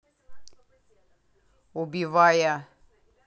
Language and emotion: Russian, angry